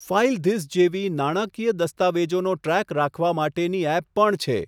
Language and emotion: Gujarati, neutral